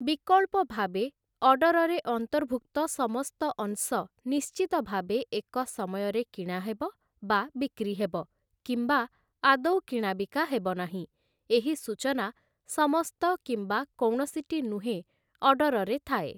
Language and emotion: Odia, neutral